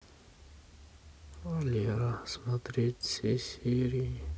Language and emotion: Russian, sad